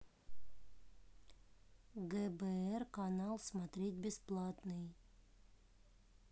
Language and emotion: Russian, neutral